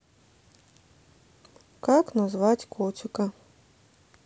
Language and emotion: Russian, neutral